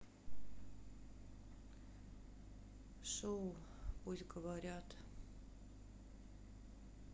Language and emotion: Russian, sad